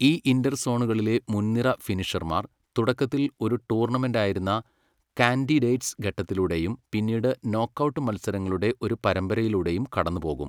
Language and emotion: Malayalam, neutral